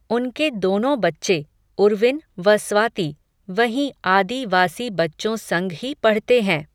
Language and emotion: Hindi, neutral